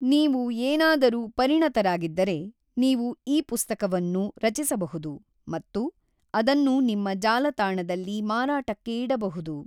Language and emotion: Kannada, neutral